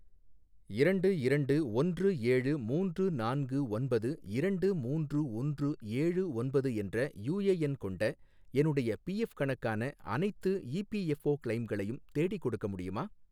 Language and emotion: Tamil, neutral